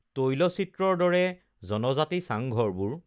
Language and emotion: Assamese, neutral